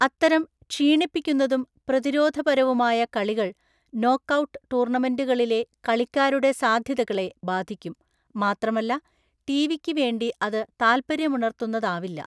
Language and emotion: Malayalam, neutral